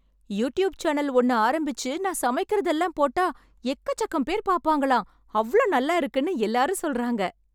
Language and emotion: Tamil, happy